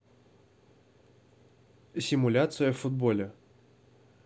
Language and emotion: Russian, neutral